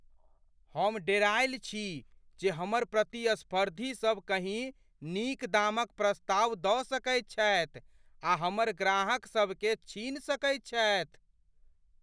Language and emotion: Maithili, fearful